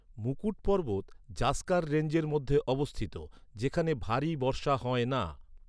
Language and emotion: Bengali, neutral